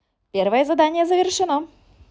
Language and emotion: Russian, positive